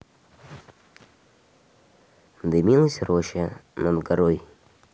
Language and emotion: Russian, neutral